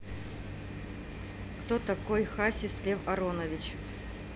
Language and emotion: Russian, neutral